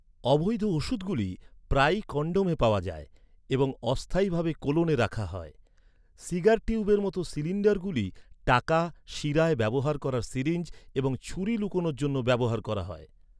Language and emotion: Bengali, neutral